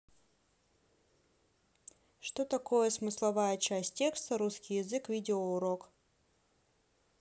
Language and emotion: Russian, neutral